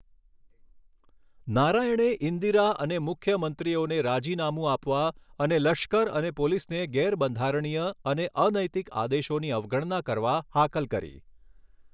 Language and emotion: Gujarati, neutral